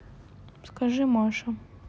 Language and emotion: Russian, sad